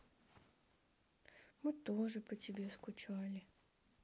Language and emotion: Russian, sad